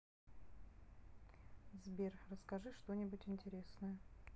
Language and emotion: Russian, neutral